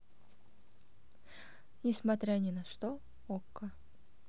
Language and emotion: Russian, neutral